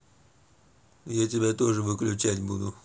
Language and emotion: Russian, neutral